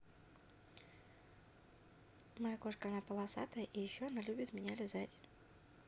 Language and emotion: Russian, neutral